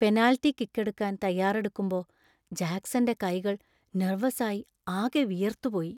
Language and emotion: Malayalam, fearful